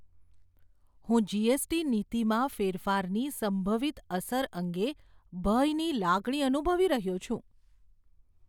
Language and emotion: Gujarati, fearful